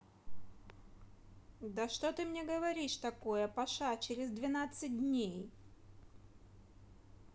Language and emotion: Russian, neutral